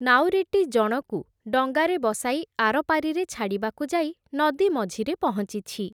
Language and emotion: Odia, neutral